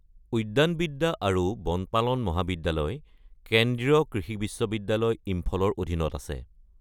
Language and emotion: Assamese, neutral